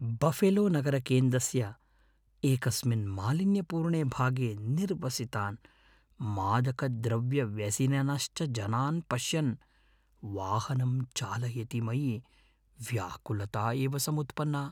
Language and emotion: Sanskrit, fearful